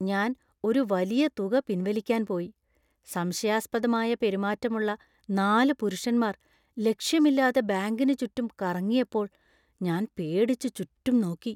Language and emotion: Malayalam, fearful